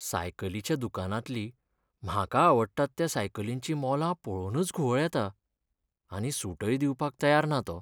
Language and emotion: Goan Konkani, sad